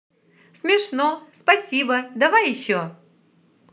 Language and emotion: Russian, positive